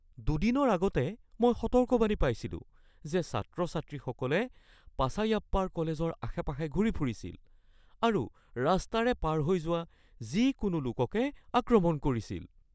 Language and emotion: Assamese, fearful